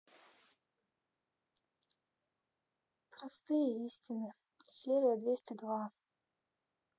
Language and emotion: Russian, sad